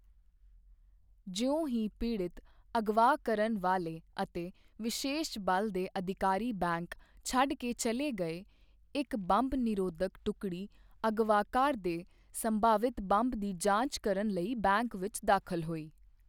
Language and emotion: Punjabi, neutral